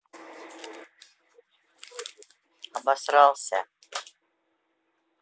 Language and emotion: Russian, neutral